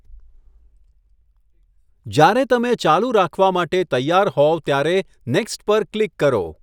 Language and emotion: Gujarati, neutral